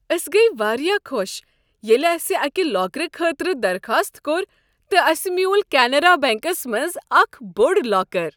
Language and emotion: Kashmiri, happy